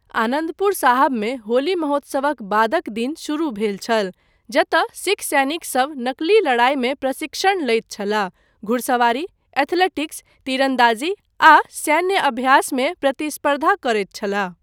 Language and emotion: Maithili, neutral